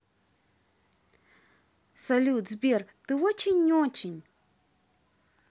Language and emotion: Russian, positive